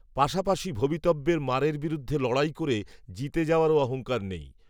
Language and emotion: Bengali, neutral